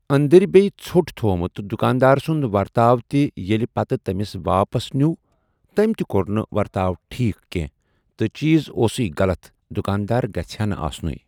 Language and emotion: Kashmiri, neutral